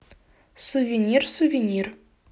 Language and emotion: Russian, neutral